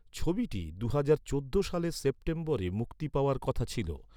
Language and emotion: Bengali, neutral